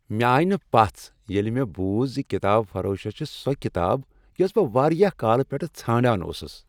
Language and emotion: Kashmiri, happy